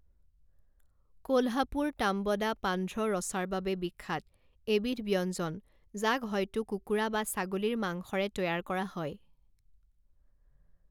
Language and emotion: Assamese, neutral